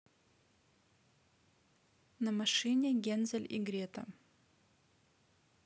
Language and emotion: Russian, neutral